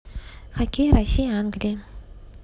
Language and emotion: Russian, neutral